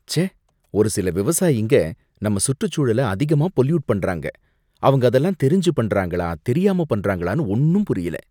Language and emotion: Tamil, disgusted